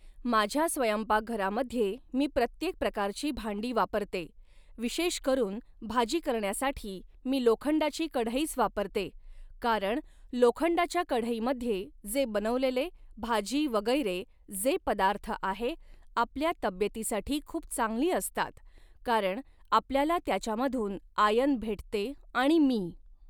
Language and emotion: Marathi, neutral